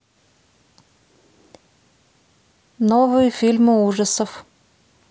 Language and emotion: Russian, neutral